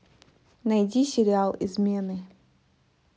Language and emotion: Russian, neutral